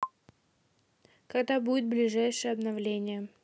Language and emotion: Russian, neutral